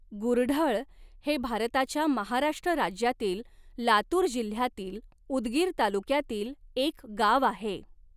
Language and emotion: Marathi, neutral